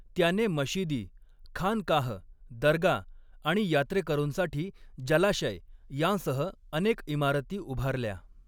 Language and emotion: Marathi, neutral